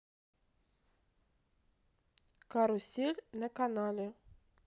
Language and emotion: Russian, neutral